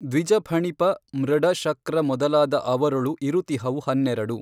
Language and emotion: Kannada, neutral